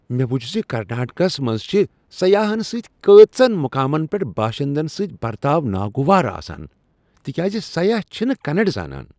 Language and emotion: Kashmiri, disgusted